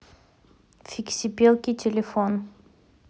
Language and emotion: Russian, neutral